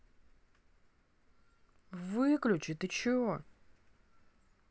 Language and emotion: Russian, angry